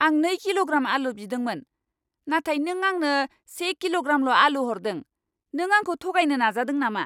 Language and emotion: Bodo, angry